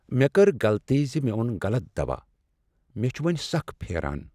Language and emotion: Kashmiri, sad